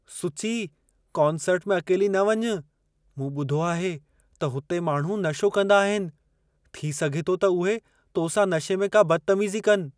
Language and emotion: Sindhi, fearful